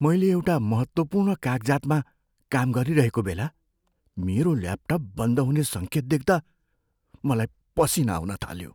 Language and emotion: Nepali, fearful